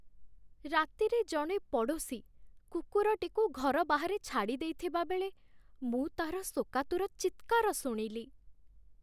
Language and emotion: Odia, sad